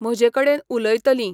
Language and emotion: Goan Konkani, neutral